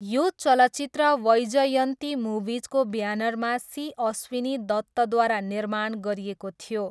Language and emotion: Nepali, neutral